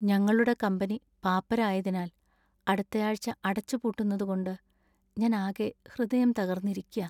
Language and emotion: Malayalam, sad